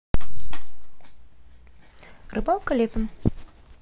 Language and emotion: Russian, neutral